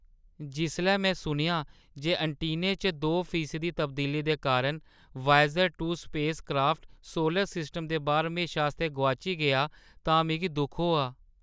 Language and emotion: Dogri, sad